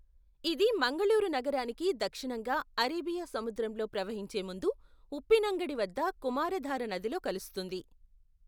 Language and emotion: Telugu, neutral